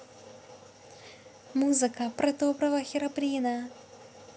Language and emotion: Russian, positive